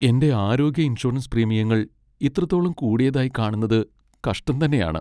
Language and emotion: Malayalam, sad